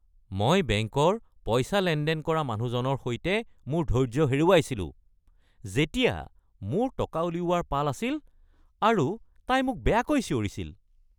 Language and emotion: Assamese, angry